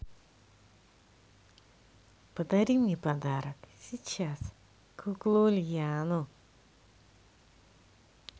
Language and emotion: Russian, positive